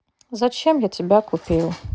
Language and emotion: Russian, sad